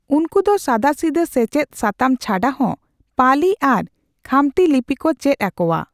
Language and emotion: Santali, neutral